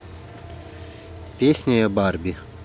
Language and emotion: Russian, neutral